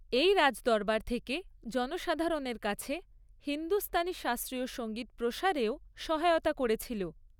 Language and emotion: Bengali, neutral